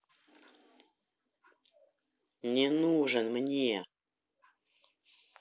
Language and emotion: Russian, angry